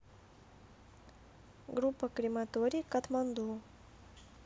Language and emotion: Russian, neutral